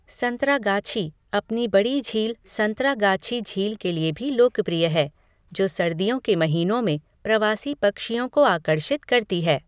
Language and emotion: Hindi, neutral